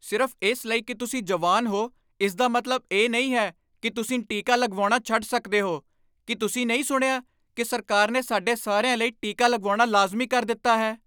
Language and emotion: Punjabi, angry